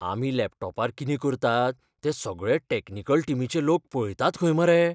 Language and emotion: Goan Konkani, fearful